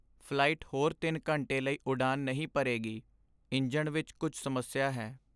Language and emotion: Punjabi, sad